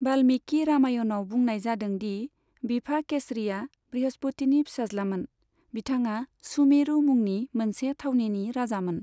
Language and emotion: Bodo, neutral